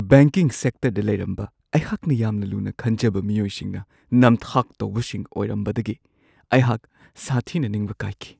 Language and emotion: Manipuri, sad